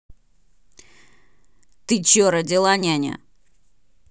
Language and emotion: Russian, angry